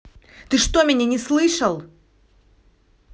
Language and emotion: Russian, angry